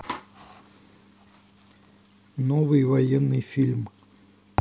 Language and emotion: Russian, neutral